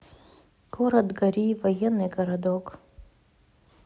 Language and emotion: Russian, neutral